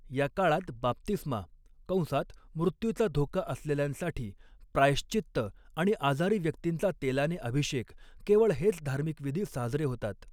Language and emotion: Marathi, neutral